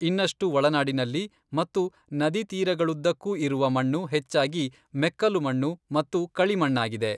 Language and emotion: Kannada, neutral